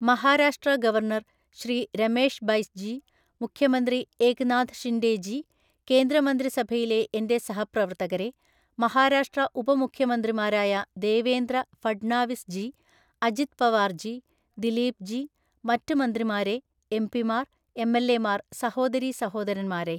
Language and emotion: Malayalam, neutral